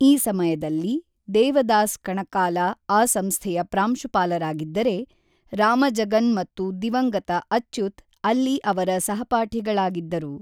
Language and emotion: Kannada, neutral